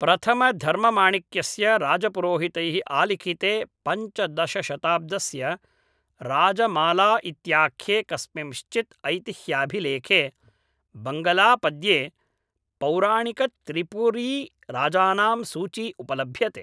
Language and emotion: Sanskrit, neutral